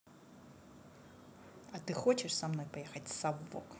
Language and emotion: Russian, neutral